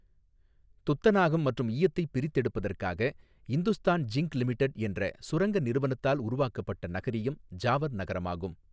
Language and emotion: Tamil, neutral